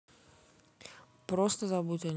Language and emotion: Russian, neutral